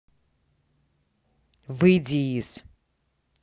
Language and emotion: Russian, angry